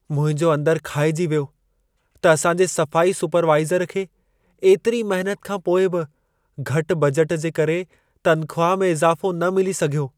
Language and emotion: Sindhi, sad